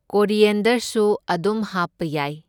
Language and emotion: Manipuri, neutral